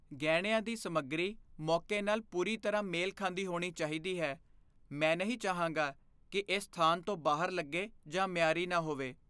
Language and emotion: Punjabi, fearful